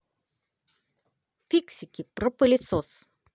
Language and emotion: Russian, positive